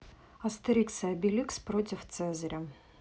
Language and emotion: Russian, neutral